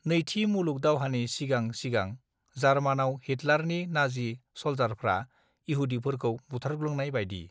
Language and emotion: Bodo, neutral